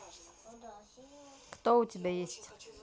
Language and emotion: Russian, neutral